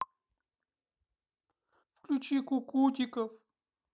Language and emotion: Russian, sad